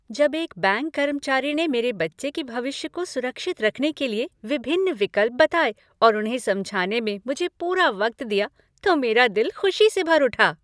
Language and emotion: Hindi, happy